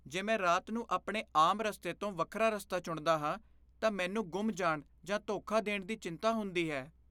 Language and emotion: Punjabi, fearful